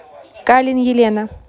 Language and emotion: Russian, neutral